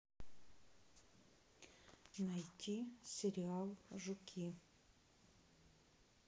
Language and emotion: Russian, neutral